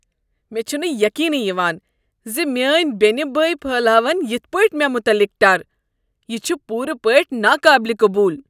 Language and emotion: Kashmiri, disgusted